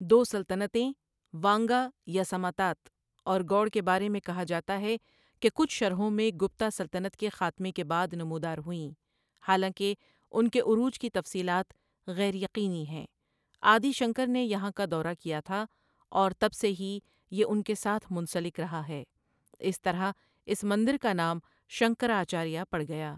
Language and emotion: Urdu, neutral